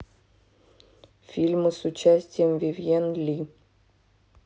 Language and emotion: Russian, neutral